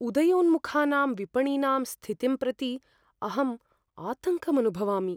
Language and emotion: Sanskrit, fearful